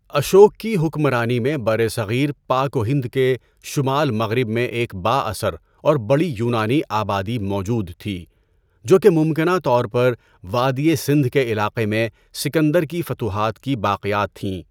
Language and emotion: Urdu, neutral